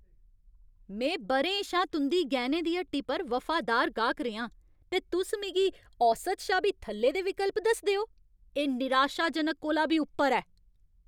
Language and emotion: Dogri, angry